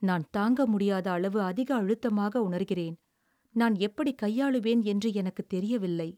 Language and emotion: Tamil, sad